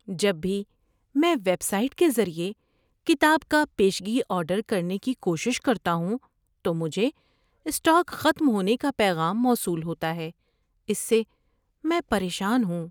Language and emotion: Urdu, sad